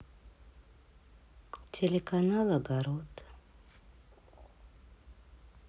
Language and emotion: Russian, sad